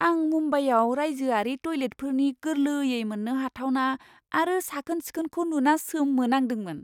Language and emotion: Bodo, surprised